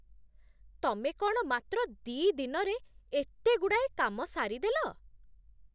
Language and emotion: Odia, surprised